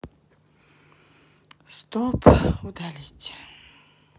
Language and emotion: Russian, sad